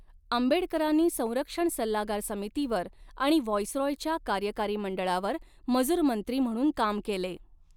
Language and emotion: Marathi, neutral